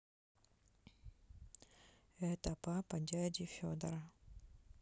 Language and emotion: Russian, neutral